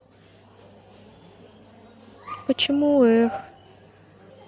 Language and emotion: Russian, sad